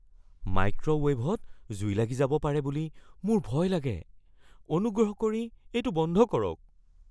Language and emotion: Assamese, fearful